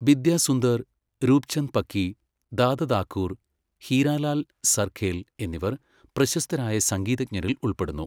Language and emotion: Malayalam, neutral